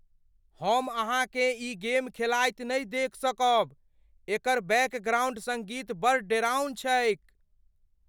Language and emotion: Maithili, fearful